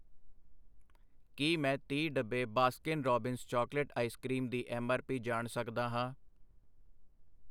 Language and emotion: Punjabi, neutral